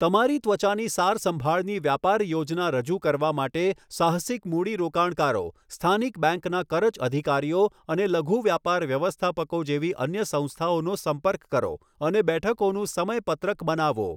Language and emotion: Gujarati, neutral